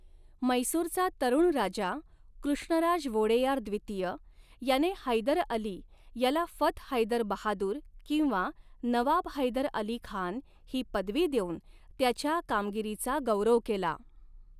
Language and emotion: Marathi, neutral